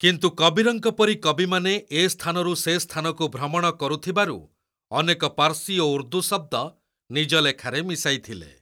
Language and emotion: Odia, neutral